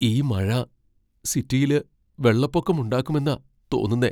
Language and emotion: Malayalam, fearful